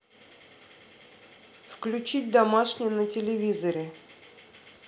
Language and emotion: Russian, neutral